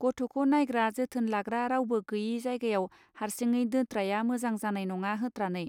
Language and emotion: Bodo, neutral